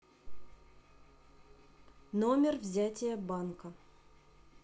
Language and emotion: Russian, neutral